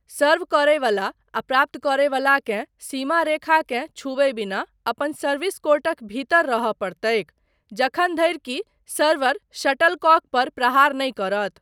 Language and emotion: Maithili, neutral